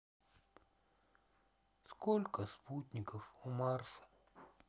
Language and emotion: Russian, sad